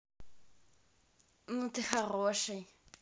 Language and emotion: Russian, neutral